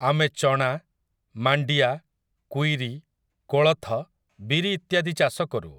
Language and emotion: Odia, neutral